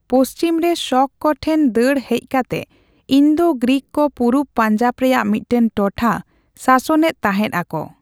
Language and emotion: Santali, neutral